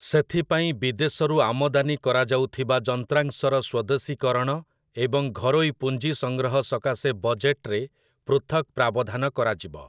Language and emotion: Odia, neutral